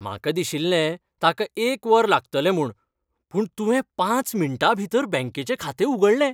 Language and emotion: Goan Konkani, happy